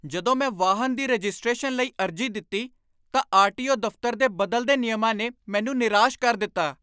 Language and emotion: Punjabi, angry